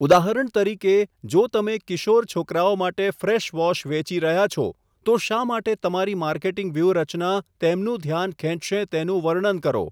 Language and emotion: Gujarati, neutral